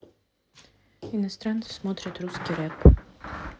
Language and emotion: Russian, neutral